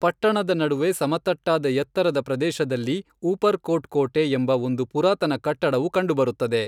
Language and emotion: Kannada, neutral